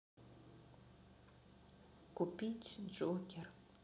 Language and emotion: Russian, sad